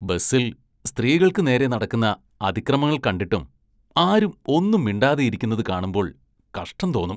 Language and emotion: Malayalam, disgusted